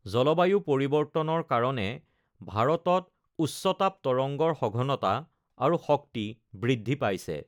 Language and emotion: Assamese, neutral